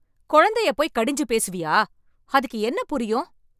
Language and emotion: Tamil, angry